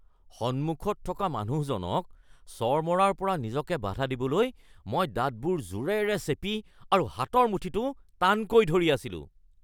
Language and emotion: Assamese, angry